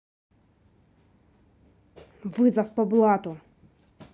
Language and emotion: Russian, angry